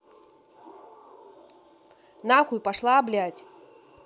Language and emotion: Russian, angry